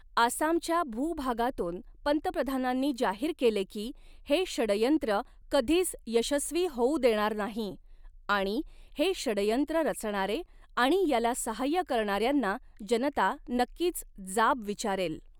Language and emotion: Marathi, neutral